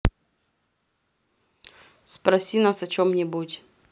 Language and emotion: Russian, neutral